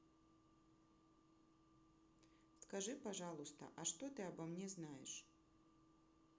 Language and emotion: Russian, neutral